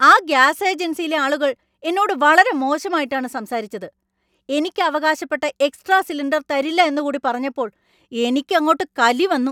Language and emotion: Malayalam, angry